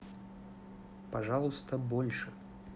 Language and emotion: Russian, neutral